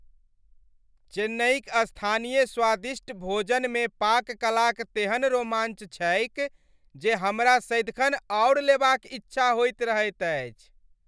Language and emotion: Maithili, happy